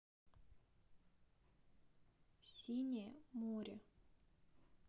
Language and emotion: Russian, neutral